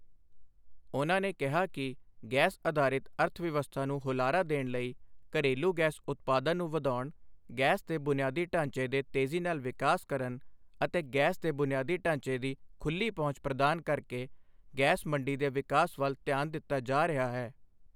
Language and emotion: Punjabi, neutral